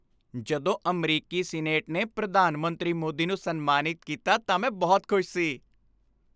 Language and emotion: Punjabi, happy